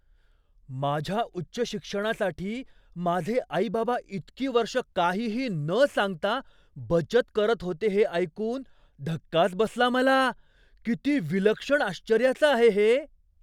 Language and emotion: Marathi, surprised